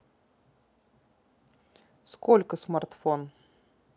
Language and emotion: Russian, neutral